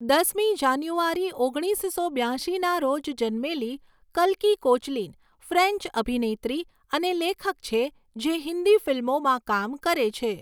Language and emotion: Gujarati, neutral